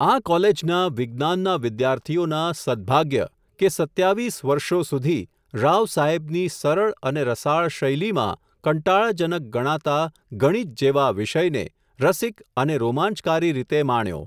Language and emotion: Gujarati, neutral